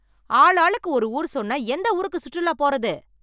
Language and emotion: Tamil, angry